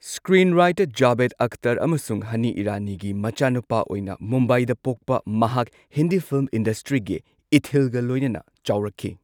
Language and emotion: Manipuri, neutral